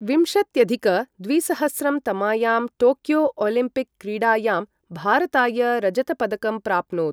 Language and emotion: Sanskrit, neutral